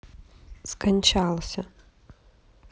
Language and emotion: Russian, sad